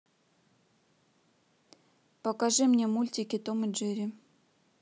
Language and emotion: Russian, neutral